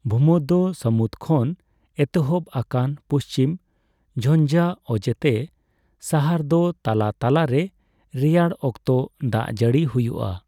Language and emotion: Santali, neutral